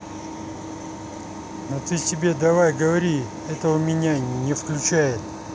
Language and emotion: Russian, neutral